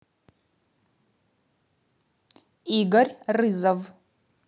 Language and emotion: Russian, neutral